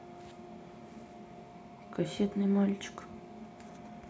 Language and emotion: Russian, sad